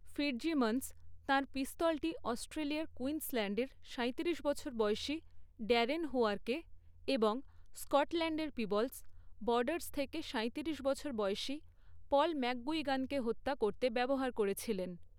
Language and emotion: Bengali, neutral